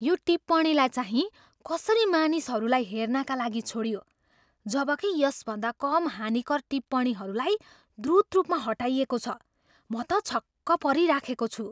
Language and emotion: Nepali, surprised